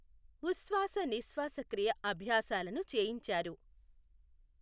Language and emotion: Telugu, neutral